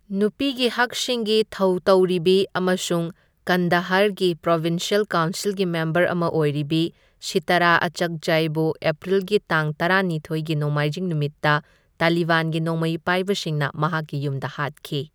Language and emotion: Manipuri, neutral